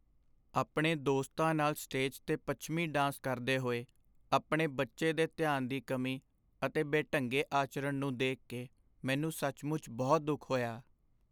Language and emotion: Punjabi, sad